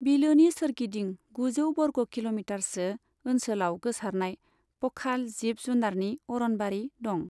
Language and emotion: Bodo, neutral